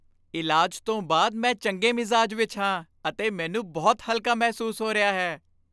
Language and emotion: Punjabi, happy